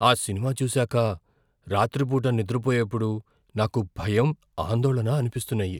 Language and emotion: Telugu, fearful